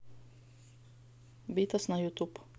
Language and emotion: Russian, neutral